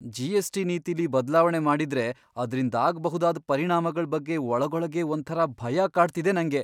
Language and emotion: Kannada, fearful